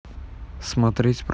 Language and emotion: Russian, neutral